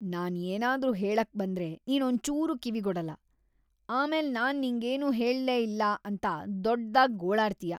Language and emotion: Kannada, disgusted